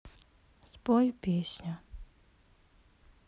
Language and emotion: Russian, sad